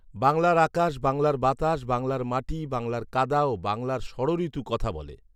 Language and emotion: Bengali, neutral